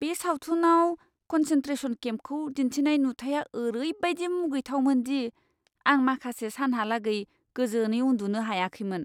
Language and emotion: Bodo, disgusted